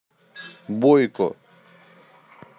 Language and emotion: Russian, neutral